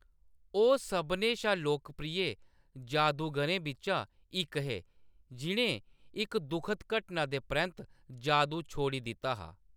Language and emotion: Dogri, neutral